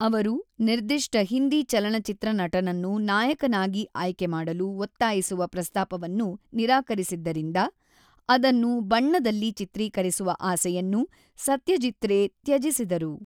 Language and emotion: Kannada, neutral